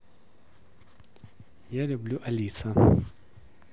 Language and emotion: Russian, neutral